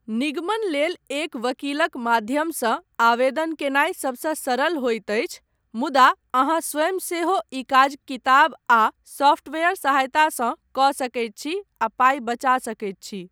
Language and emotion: Maithili, neutral